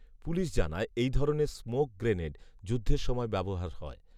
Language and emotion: Bengali, neutral